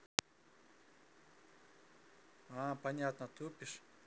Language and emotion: Russian, neutral